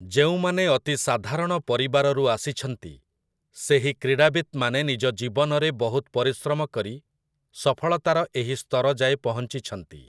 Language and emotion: Odia, neutral